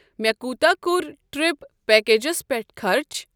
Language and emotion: Kashmiri, neutral